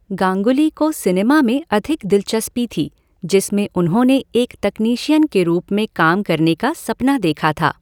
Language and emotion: Hindi, neutral